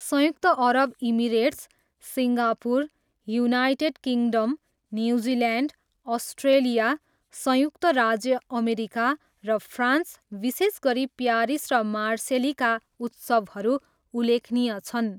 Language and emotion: Nepali, neutral